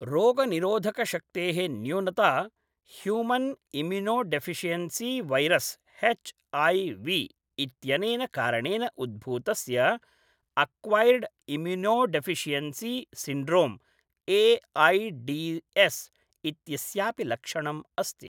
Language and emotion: Sanskrit, neutral